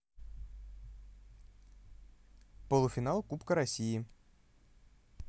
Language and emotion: Russian, neutral